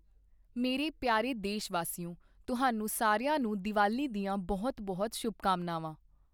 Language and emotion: Punjabi, neutral